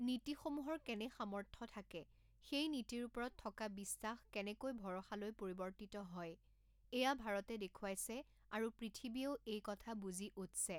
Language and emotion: Assamese, neutral